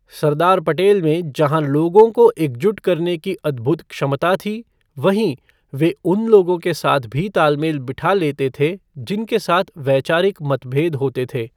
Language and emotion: Hindi, neutral